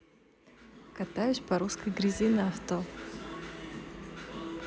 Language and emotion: Russian, positive